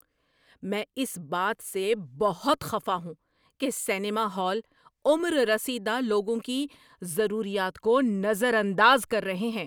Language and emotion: Urdu, angry